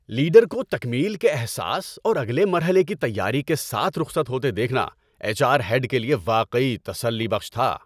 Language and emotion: Urdu, happy